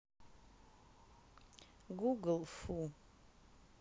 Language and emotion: Russian, neutral